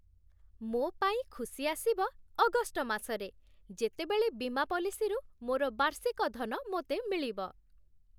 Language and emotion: Odia, happy